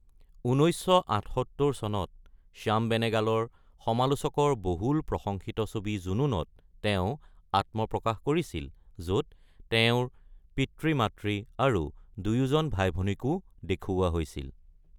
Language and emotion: Assamese, neutral